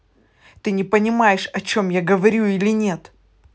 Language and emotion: Russian, angry